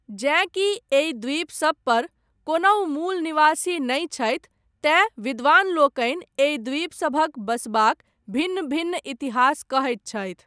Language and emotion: Maithili, neutral